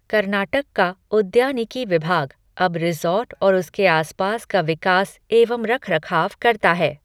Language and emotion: Hindi, neutral